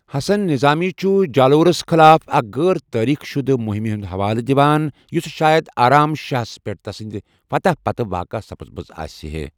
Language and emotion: Kashmiri, neutral